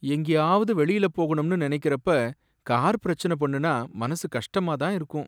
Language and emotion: Tamil, sad